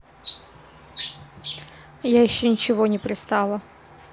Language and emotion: Russian, neutral